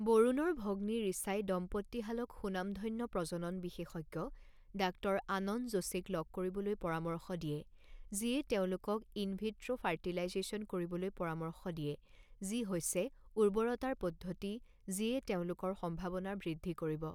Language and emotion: Assamese, neutral